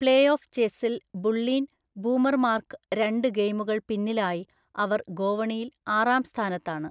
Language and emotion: Malayalam, neutral